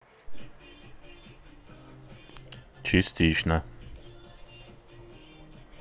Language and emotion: Russian, neutral